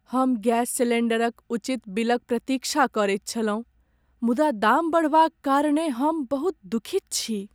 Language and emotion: Maithili, sad